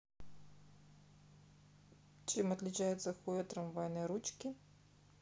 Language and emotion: Russian, neutral